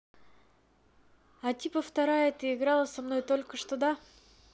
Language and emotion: Russian, neutral